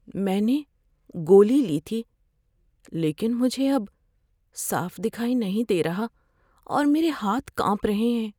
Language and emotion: Urdu, fearful